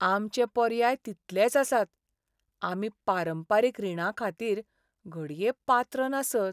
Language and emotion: Goan Konkani, sad